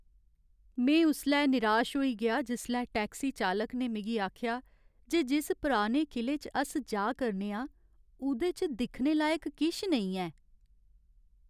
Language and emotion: Dogri, sad